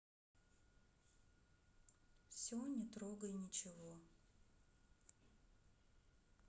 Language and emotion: Russian, sad